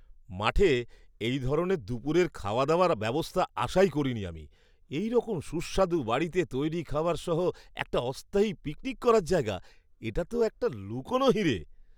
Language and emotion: Bengali, surprised